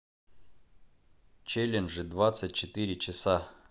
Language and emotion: Russian, neutral